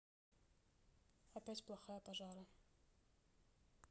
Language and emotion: Russian, neutral